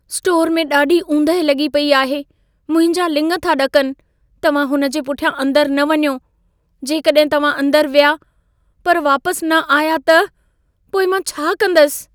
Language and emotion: Sindhi, fearful